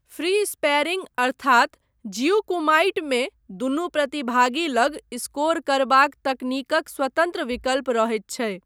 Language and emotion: Maithili, neutral